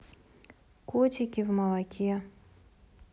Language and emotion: Russian, neutral